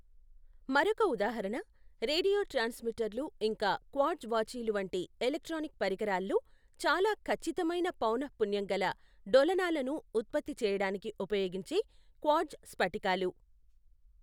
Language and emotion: Telugu, neutral